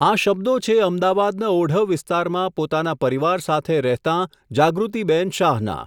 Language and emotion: Gujarati, neutral